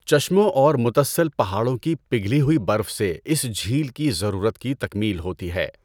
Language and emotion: Urdu, neutral